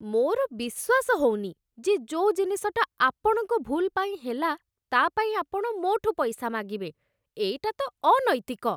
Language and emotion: Odia, disgusted